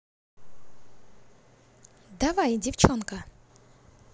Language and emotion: Russian, positive